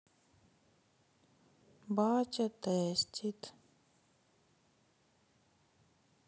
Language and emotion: Russian, sad